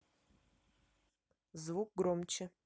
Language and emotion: Russian, neutral